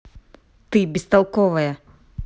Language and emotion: Russian, angry